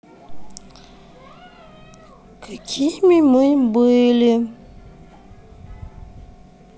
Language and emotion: Russian, sad